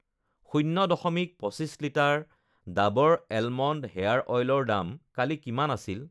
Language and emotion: Assamese, neutral